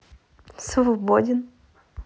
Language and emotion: Russian, neutral